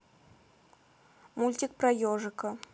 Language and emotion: Russian, neutral